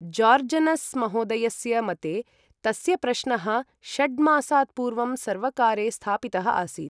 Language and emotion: Sanskrit, neutral